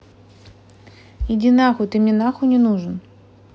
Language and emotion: Russian, angry